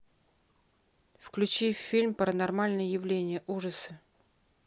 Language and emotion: Russian, neutral